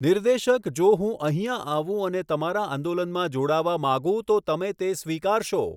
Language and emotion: Gujarati, neutral